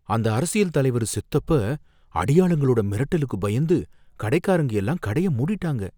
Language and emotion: Tamil, fearful